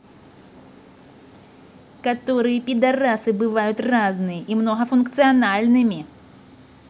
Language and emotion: Russian, angry